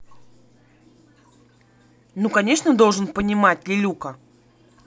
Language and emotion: Russian, angry